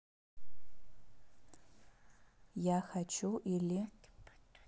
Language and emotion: Russian, neutral